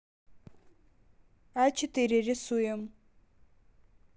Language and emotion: Russian, neutral